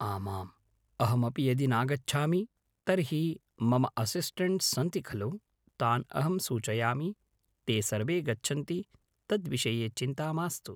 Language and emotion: Sanskrit, neutral